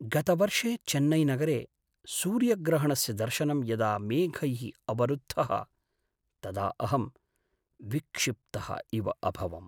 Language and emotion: Sanskrit, sad